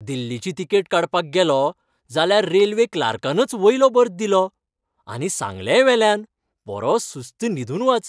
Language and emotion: Goan Konkani, happy